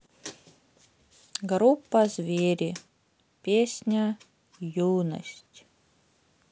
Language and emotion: Russian, sad